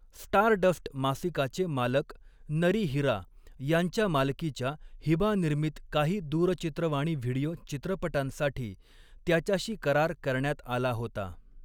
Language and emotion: Marathi, neutral